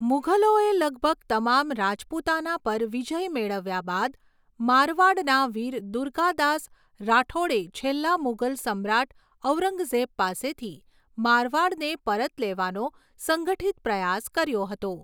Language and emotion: Gujarati, neutral